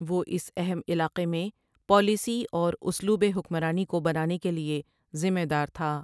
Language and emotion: Urdu, neutral